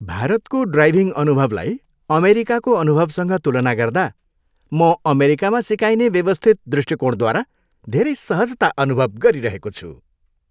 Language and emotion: Nepali, happy